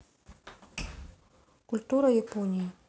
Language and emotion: Russian, neutral